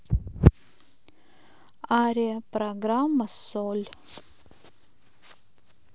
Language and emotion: Russian, neutral